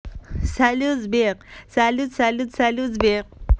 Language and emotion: Russian, positive